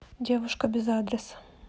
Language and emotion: Russian, neutral